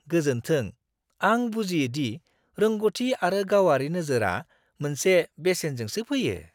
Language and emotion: Bodo, surprised